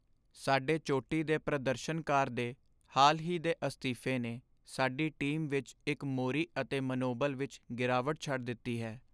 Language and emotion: Punjabi, sad